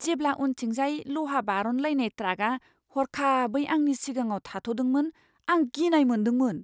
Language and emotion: Bodo, fearful